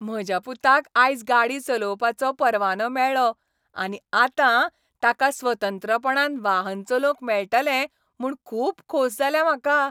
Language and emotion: Goan Konkani, happy